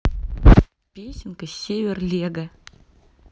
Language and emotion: Russian, neutral